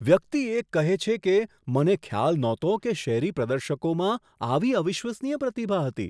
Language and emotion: Gujarati, surprised